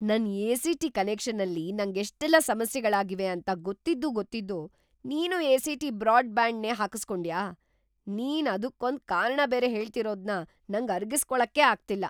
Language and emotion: Kannada, surprised